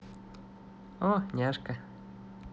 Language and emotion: Russian, positive